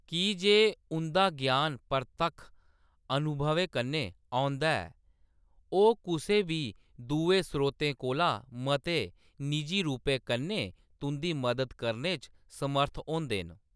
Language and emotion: Dogri, neutral